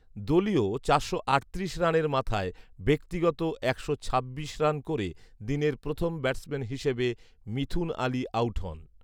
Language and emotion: Bengali, neutral